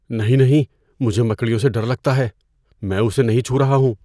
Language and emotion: Urdu, fearful